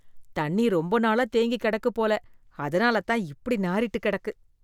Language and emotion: Tamil, disgusted